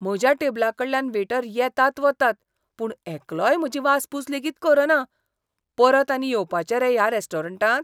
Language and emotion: Goan Konkani, disgusted